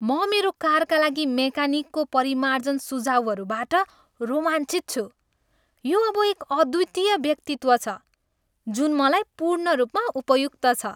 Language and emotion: Nepali, happy